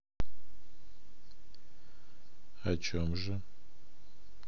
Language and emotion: Russian, neutral